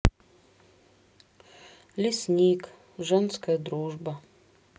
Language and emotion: Russian, sad